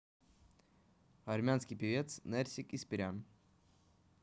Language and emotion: Russian, neutral